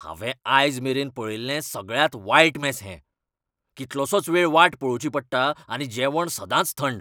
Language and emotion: Goan Konkani, angry